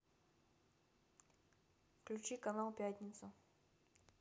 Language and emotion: Russian, neutral